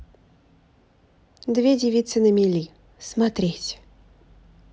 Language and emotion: Russian, neutral